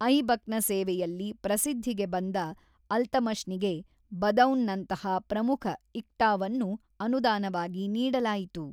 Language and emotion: Kannada, neutral